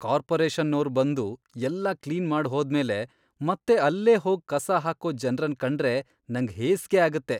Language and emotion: Kannada, disgusted